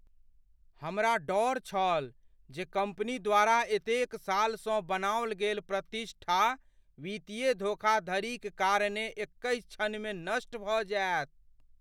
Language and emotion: Maithili, fearful